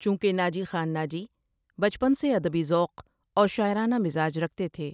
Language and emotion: Urdu, neutral